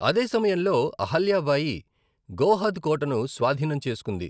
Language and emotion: Telugu, neutral